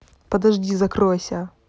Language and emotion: Russian, angry